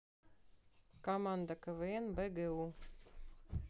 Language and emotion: Russian, neutral